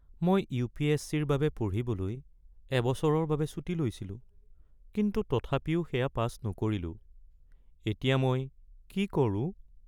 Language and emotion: Assamese, sad